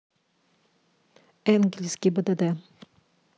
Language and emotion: Russian, neutral